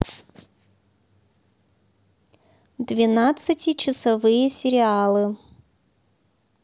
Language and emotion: Russian, neutral